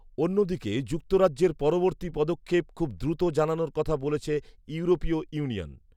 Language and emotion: Bengali, neutral